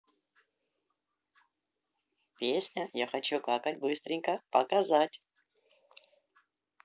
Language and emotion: Russian, positive